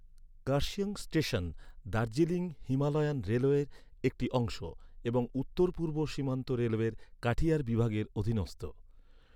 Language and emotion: Bengali, neutral